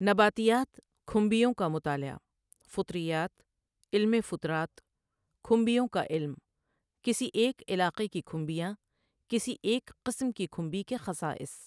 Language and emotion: Urdu, neutral